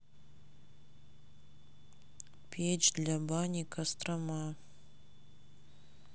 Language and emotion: Russian, sad